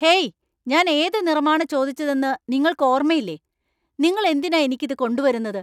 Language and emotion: Malayalam, angry